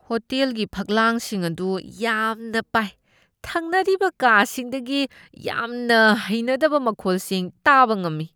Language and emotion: Manipuri, disgusted